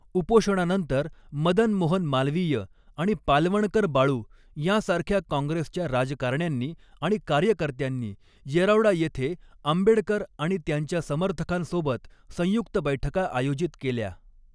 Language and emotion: Marathi, neutral